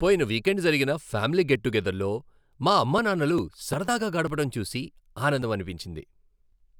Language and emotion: Telugu, happy